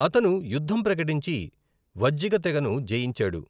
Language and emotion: Telugu, neutral